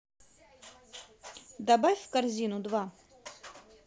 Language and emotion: Russian, positive